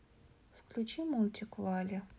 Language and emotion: Russian, neutral